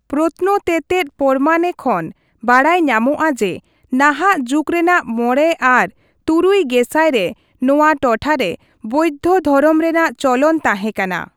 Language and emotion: Santali, neutral